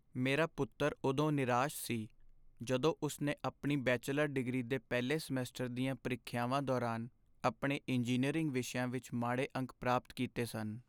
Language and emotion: Punjabi, sad